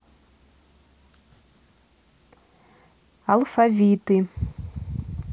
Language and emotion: Russian, neutral